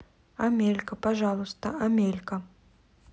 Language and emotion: Russian, neutral